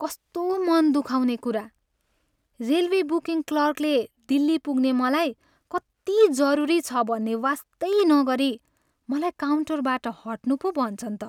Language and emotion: Nepali, sad